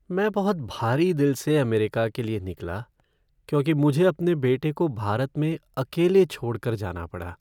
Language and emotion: Hindi, sad